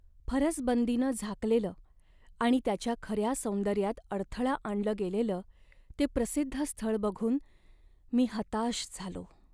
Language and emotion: Marathi, sad